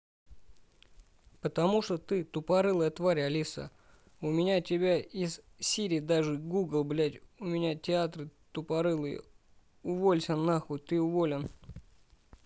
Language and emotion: Russian, angry